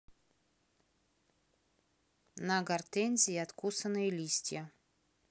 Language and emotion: Russian, neutral